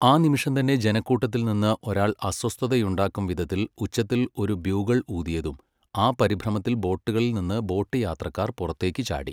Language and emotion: Malayalam, neutral